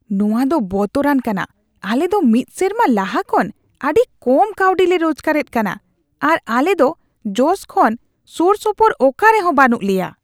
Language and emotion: Santali, disgusted